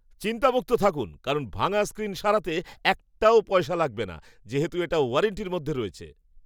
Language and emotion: Bengali, happy